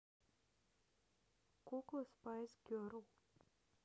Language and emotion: Russian, neutral